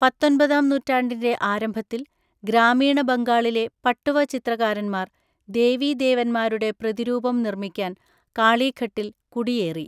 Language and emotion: Malayalam, neutral